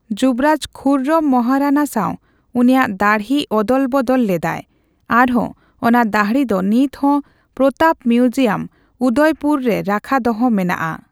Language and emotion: Santali, neutral